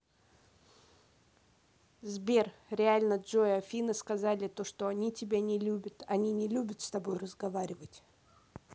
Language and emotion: Russian, neutral